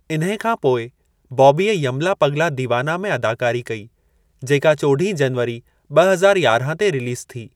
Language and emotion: Sindhi, neutral